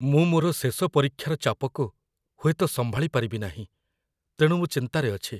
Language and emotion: Odia, fearful